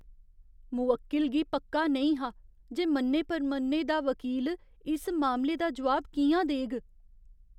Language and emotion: Dogri, fearful